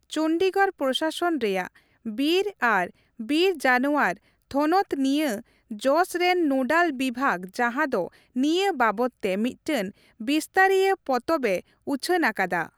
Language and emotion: Santali, neutral